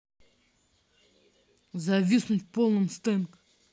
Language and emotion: Russian, angry